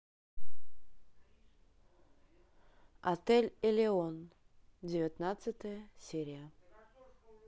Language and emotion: Russian, neutral